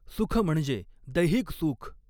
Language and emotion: Marathi, neutral